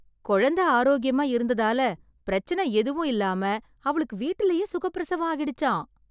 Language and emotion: Tamil, surprised